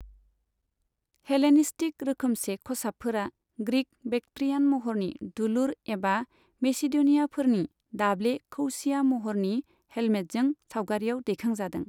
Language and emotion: Bodo, neutral